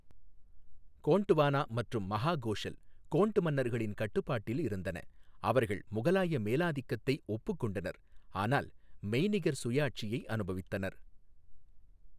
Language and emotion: Tamil, neutral